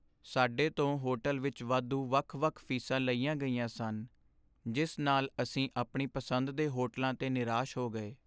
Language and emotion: Punjabi, sad